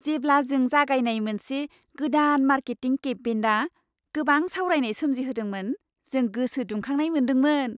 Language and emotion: Bodo, happy